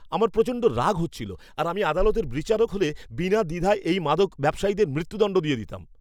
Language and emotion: Bengali, angry